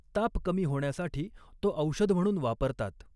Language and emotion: Marathi, neutral